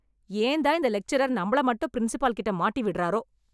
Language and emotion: Tamil, angry